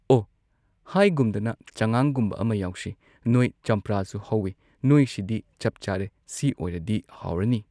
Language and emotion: Manipuri, neutral